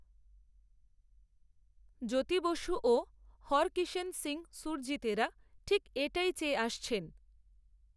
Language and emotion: Bengali, neutral